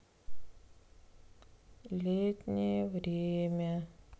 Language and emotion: Russian, sad